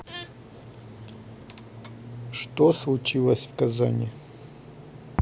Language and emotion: Russian, neutral